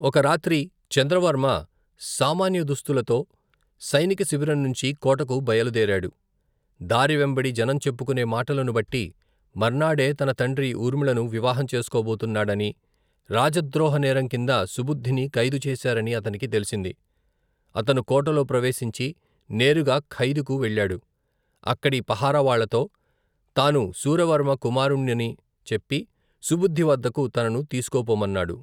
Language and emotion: Telugu, neutral